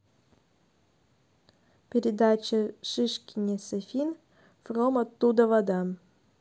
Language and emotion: Russian, neutral